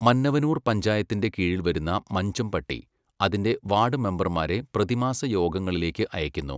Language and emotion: Malayalam, neutral